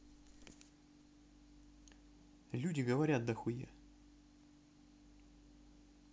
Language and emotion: Russian, neutral